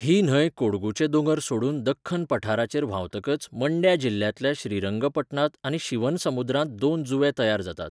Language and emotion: Goan Konkani, neutral